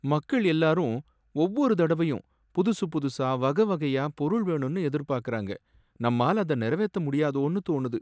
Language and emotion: Tamil, sad